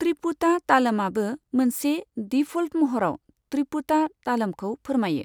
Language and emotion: Bodo, neutral